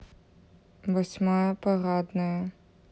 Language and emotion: Russian, neutral